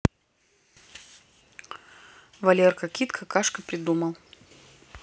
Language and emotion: Russian, neutral